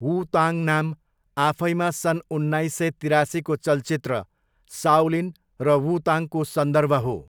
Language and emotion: Nepali, neutral